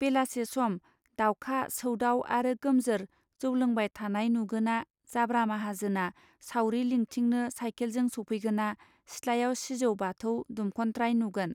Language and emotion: Bodo, neutral